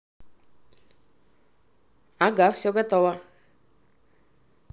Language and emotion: Russian, neutral